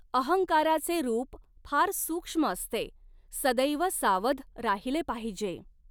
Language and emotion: Marathi, neutral